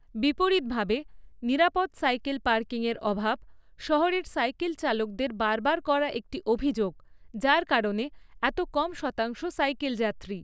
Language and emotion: Bengali, neutral